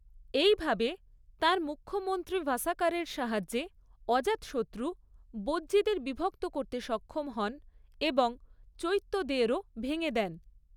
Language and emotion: Bengali, neutral